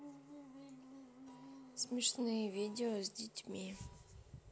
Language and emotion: Russian, neutral